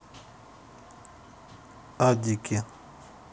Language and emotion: Russian, neutral